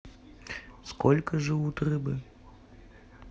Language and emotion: Russian, neutral